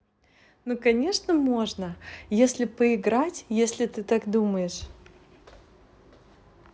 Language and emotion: Russian, positive